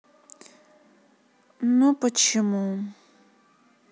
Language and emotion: Russian, sad